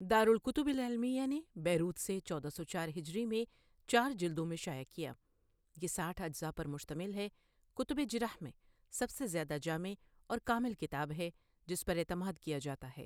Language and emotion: Urdu, neutral